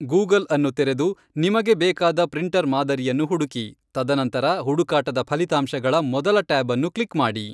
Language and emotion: Kannada, neutral